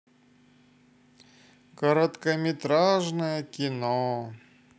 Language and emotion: Russian, sad